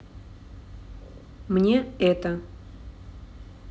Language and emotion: Russian, neutral